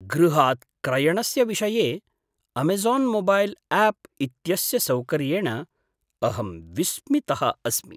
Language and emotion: Sanskrit, surprised